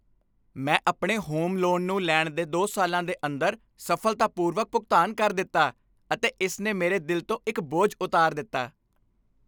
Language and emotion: Punjabi, happy